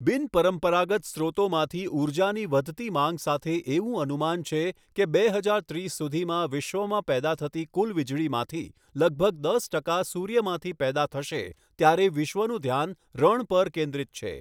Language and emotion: Gujarati, neutral